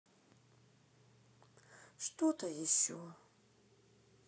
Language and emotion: Russian, sad